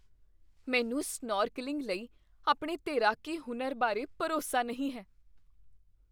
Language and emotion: Punjabi, fearful